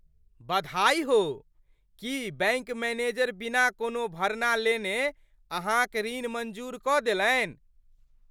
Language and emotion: Maithili, surprised